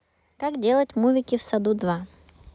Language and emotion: Russian, neutral